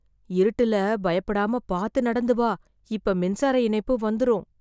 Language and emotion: Tamil, fearful